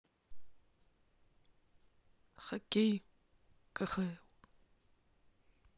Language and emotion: Russian, neutral